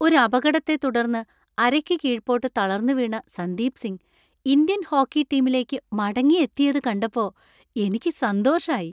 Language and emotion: Malayalam, happy